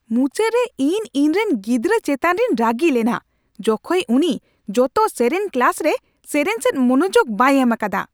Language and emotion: Santali, angry